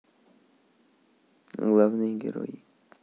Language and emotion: Russian, neutral